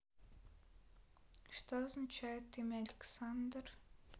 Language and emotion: Russian, neutral